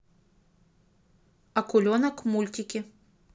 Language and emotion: Russian, neutral